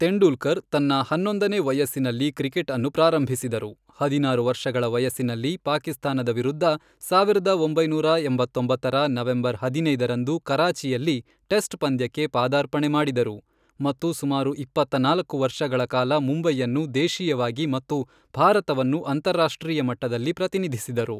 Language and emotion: Kannada, neutral